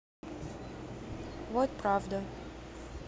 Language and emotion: Russian, neutral